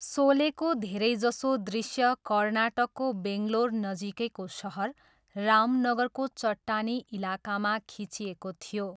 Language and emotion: Nepali, neutral